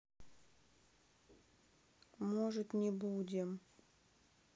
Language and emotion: Russian, sad